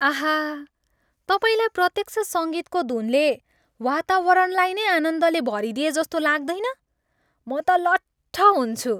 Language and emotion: Nepali, happy